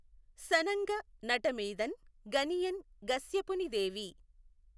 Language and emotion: Telugu, neutral